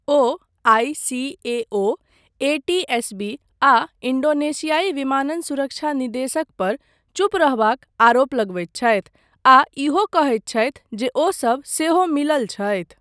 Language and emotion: Maithili, neutral